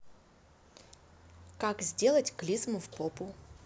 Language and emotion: Russian, neutral